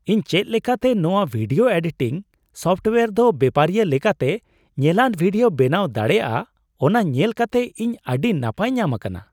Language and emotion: Santali, surprised